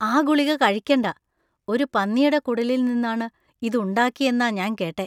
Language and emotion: Malayalam, disgusted